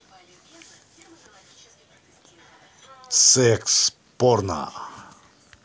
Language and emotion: Russian, positive